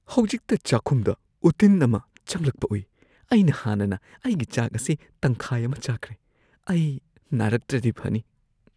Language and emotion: Manipuri, fearful